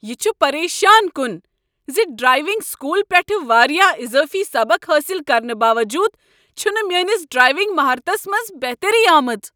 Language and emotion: Kashmiri, angry